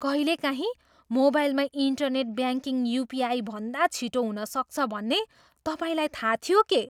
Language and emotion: Nepali, surprised